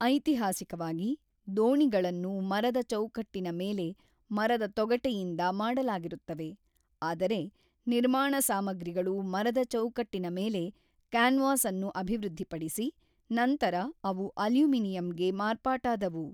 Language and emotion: Kannada, neutral